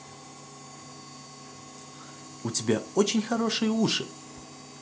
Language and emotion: Russian, positive